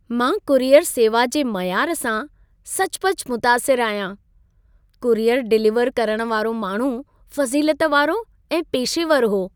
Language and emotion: Sindhi, happy